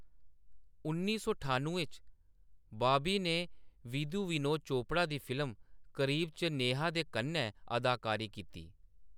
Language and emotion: Dogri, neutral